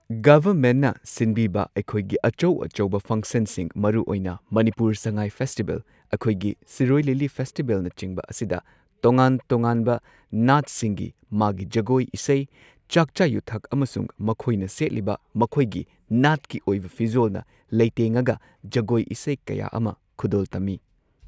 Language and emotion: Manipuri, neutral